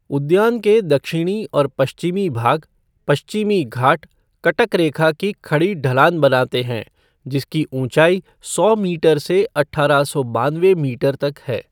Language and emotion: Hindi, neutral